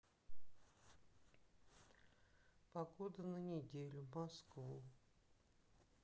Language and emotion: Russian, sad